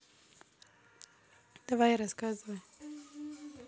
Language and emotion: Russian, neutral